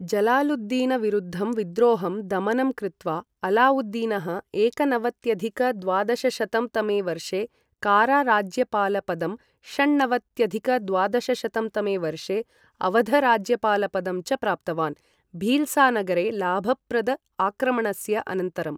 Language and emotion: Sanskrit, neutral